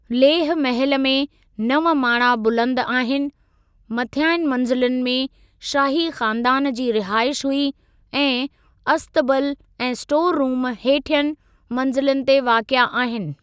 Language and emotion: Sindhi, neutral